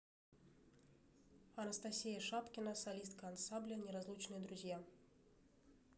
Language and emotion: Russian, neutral